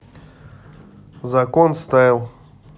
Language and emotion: Russian, neutral